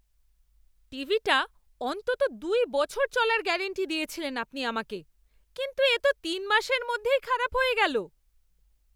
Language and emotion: Bengali, angry